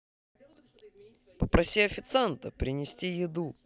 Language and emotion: Russian, positive